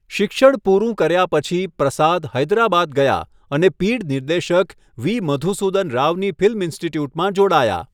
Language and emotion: Gujarati, neutral